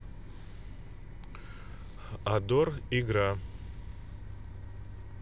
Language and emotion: Russian, neutral